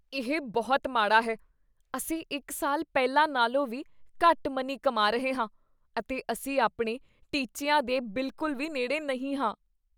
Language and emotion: Punjabi, disgusted